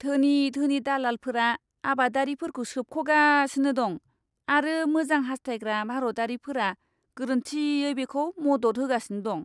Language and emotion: Bodo, disgusted